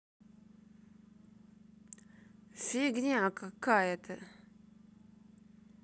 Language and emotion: Russian, angry